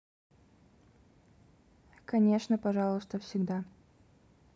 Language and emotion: Russian, neutral